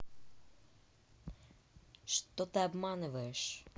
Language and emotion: Russian, angry